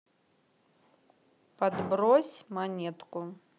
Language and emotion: Russian, neutral